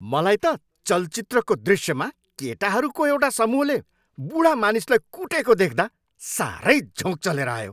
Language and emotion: Nepali, angry